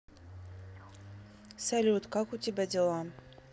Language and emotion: Russian, neutral